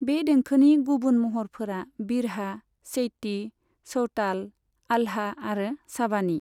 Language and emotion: Bodo, neutral